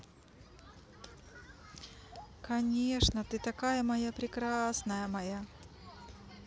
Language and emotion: Russian, positive